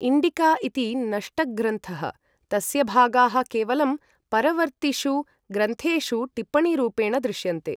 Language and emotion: Sanskrit, neutral